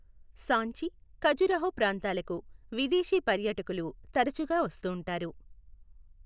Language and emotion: Telugu, neutral